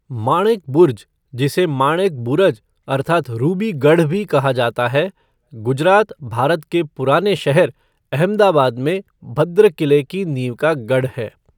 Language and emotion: Hindi, neutral